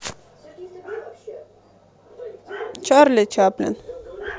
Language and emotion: Russian, neutral